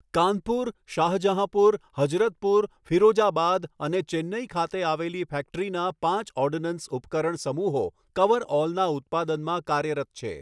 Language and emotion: Gujarati, neutral